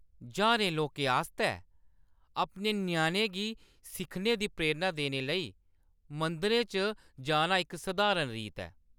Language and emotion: Dogri, neutral